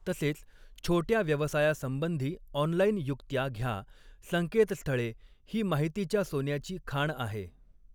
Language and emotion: Marathi, neutral